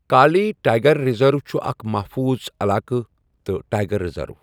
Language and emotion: Kashmiri, neutral